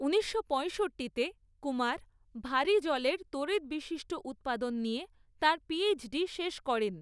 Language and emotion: Bengali, neutral